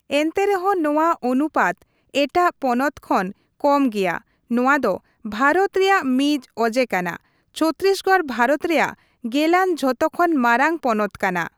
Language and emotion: Santali, neutral